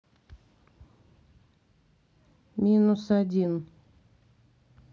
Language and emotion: Russian, neutral